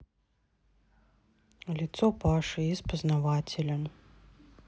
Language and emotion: Russian, neutral